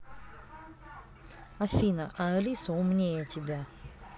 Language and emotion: Russian, neutral